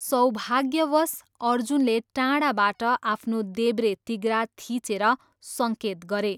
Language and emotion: Nepali, neutral